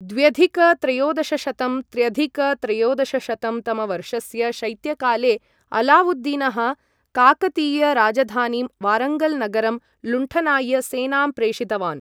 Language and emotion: Sanskrit, neutral